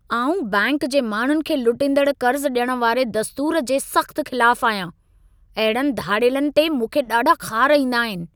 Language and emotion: Sindhi, angry